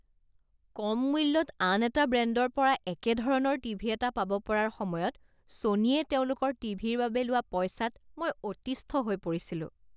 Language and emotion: Assamese, disgusted